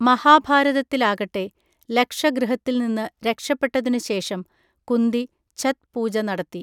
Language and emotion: Malayalam, neutral